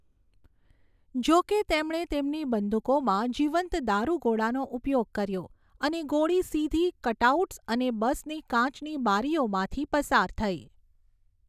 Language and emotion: Gujarati, neutral